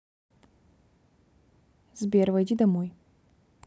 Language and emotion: Russian, neutral